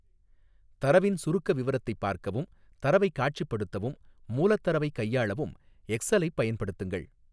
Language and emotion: Tamil, neutral